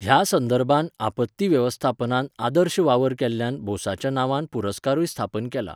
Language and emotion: Goan Konkani, neutral